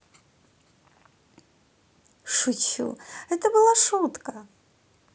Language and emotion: Russian, positive